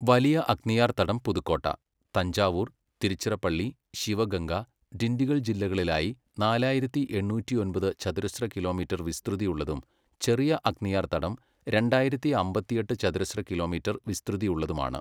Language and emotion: Malayalam, neutral